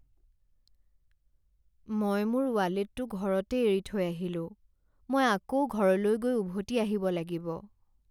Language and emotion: Assamese, sad